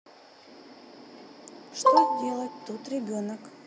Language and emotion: Russian, neutral